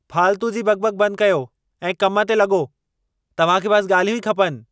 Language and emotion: Sindhi, angry